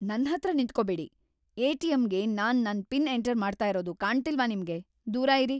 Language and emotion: Kannada, angry